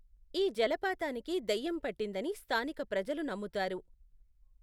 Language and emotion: Telugu, neutral